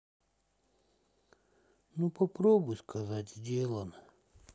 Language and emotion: Russian, sad